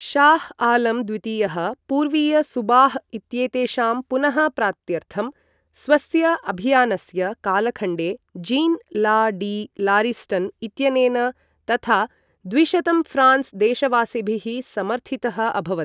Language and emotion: Sanskrit, neutral